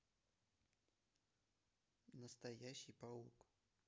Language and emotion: Russian, neutral